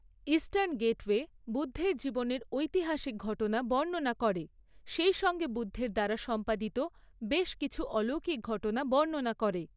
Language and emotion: Bengali, neutral